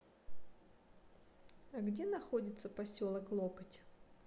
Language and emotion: Russian, neutral